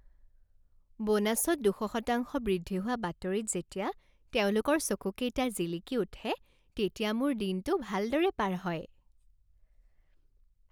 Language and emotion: Assamese, happy